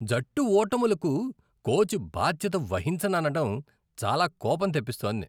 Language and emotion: Telugu, disgusted